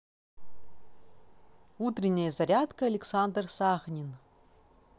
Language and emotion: Russian, positive